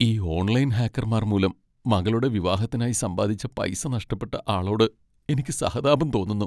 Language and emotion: Malayalam, sad